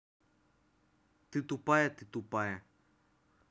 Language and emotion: Russian, neutral